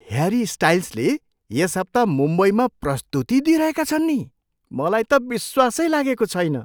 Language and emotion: Nepali, surprised